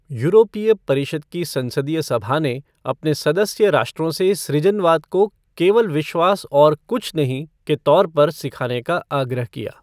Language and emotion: Hindi, neutral